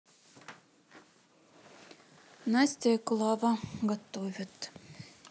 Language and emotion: Russian, neutral